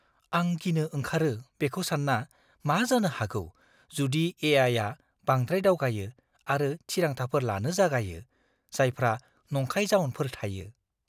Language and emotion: Bodo, fearful